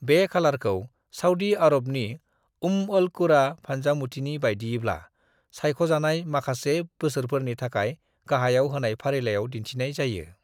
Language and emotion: Bodo, neutral